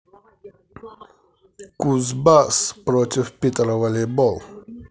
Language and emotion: Russian, positive